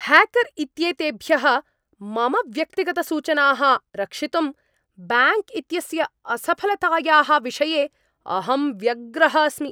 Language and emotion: Sanskrit, angry